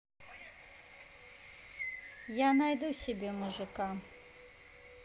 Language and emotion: Russian, neutral